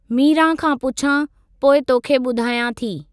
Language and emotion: Sindhi, neutral